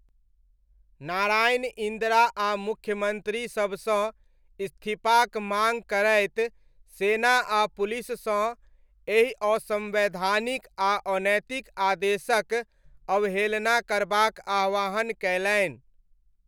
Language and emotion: Maithili, neutral